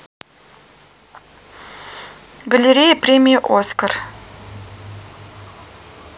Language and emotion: Russian, neutral